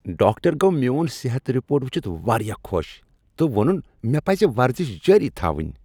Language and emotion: Kashmiri, happy